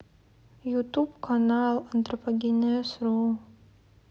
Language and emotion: Russian, sad